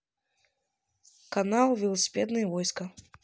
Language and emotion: Russian, neutral